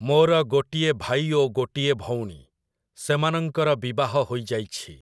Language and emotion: Odia, neutral